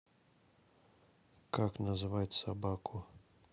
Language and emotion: Russian, neutral